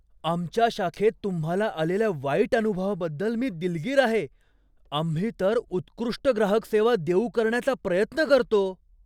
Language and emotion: Marathi, surprised